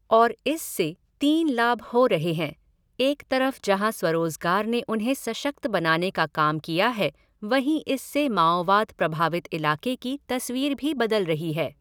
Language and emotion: Hindi, neutral